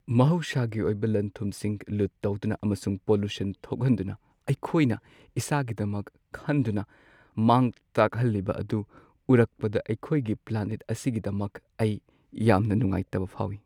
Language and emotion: Manipuri, sad